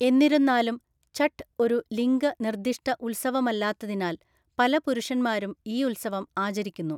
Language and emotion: Malayalam, neutral